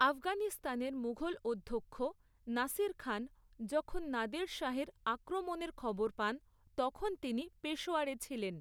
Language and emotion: Bengali, neutral